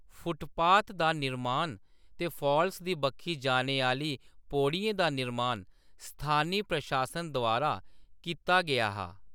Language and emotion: Dogri, neutral